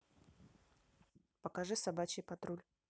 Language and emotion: Russian, neutral